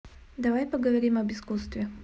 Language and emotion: Russian, neutral